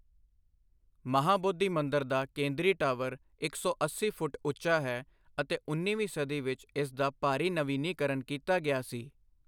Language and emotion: Punjabi, neutral